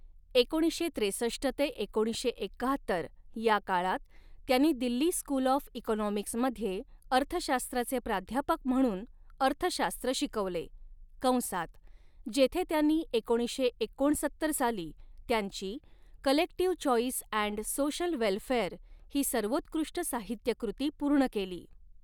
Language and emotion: Marathi, neutral